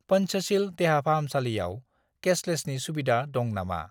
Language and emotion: Bodo, neutral